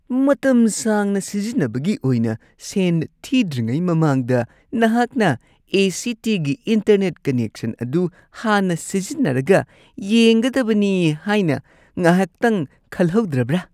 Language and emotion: Manipuri, disgusted